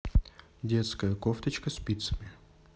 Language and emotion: Russian, neutral